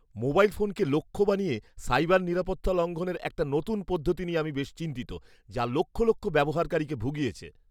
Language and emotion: Bengali, fearful